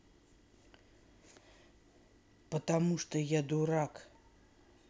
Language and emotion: Russian, neutral